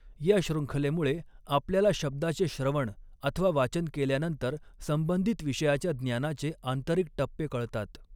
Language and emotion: Marathi, neutral